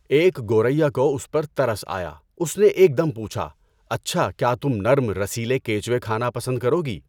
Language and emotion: Urdu, neutral